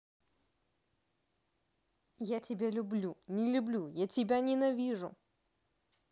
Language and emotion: Russian, angry